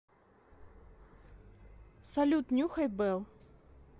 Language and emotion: Russian, neutral